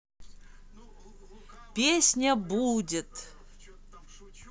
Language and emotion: Russian, positive